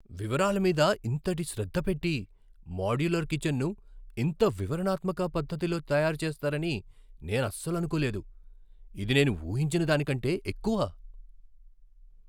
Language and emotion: Telugu, surprised